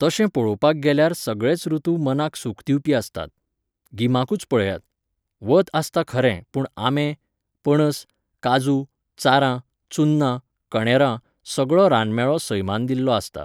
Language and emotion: Goan Konkani, neutral